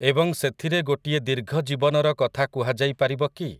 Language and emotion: Odia, neutral